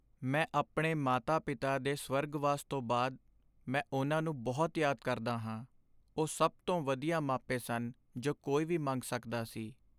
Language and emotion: Punjabi, sad